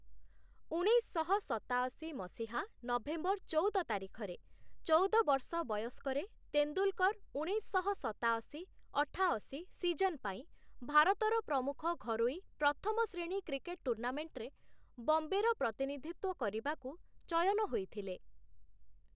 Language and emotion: Odia, neutral